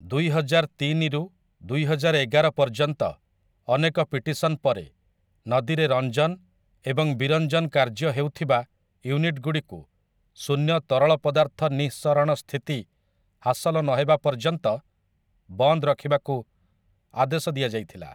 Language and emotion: Odia, neutral